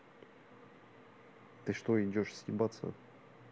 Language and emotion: Russian, neutral